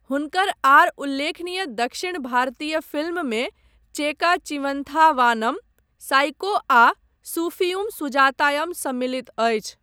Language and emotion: Maithili, neutral